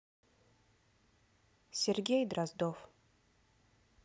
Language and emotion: Russian, neutral